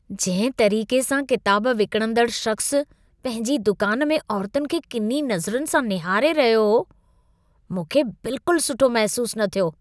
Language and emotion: Sindhi, disgusted